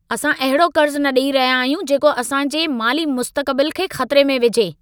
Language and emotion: Sindhi, angry